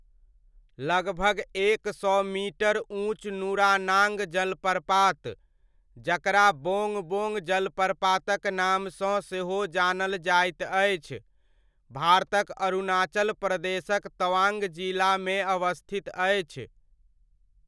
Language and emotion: Maithili, neutral